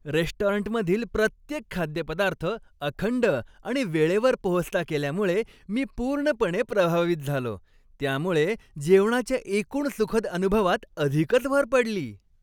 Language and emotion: Marathi, happy